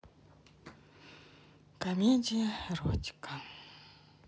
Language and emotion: Russian, sad